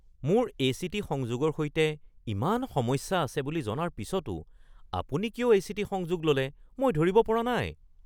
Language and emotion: Assamese, surprised